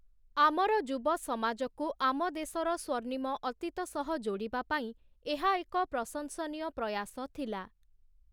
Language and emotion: Odia, neutral